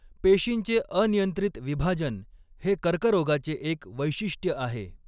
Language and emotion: Marathi, neutral